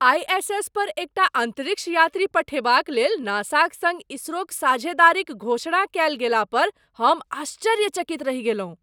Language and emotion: Maithili, surprised